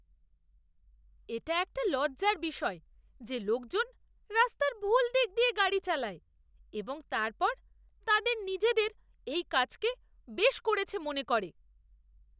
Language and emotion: Bengali, disgusted